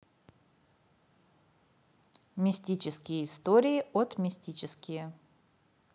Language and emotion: Russian, neutral